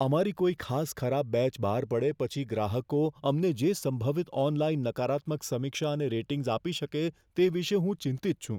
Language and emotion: Gujarati, fearful